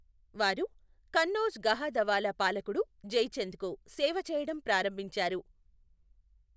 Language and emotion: Telugu, neutral